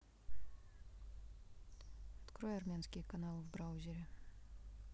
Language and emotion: Russian, neutral